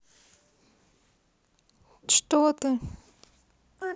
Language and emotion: Russian, neutral